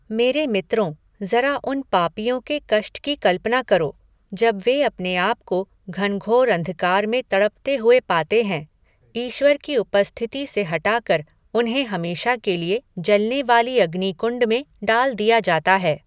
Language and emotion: Hindi, neutral